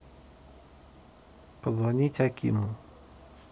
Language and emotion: Russian, neutral